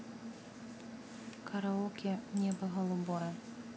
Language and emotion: Russian, neutral